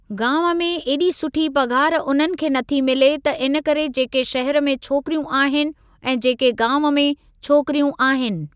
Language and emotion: Sindhi, neutral